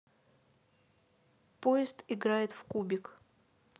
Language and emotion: Russian, neutral